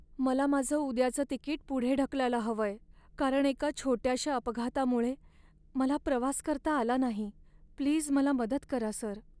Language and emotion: Marathi, sad